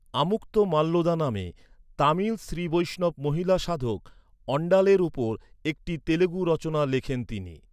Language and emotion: Bengali, neutral